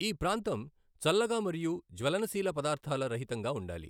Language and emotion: Telugu, neutral